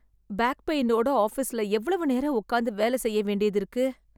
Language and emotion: Tamil, sad